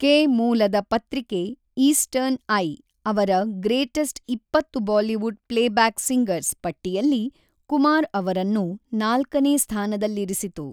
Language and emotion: Kannada, neutral